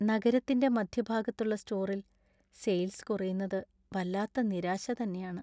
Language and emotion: Malayalam, sad